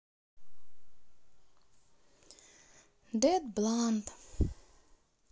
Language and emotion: Russian, sad